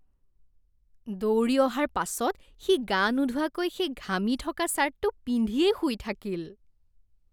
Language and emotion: Assamese, disgusted